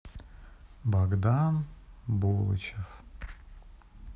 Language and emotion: Russian, sad